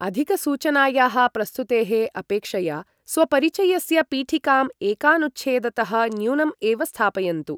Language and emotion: Sanskrit, neutral